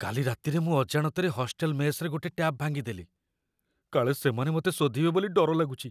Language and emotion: Odia, fearful